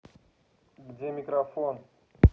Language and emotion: Russian, angry